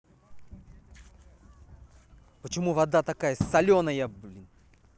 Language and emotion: Russian, angry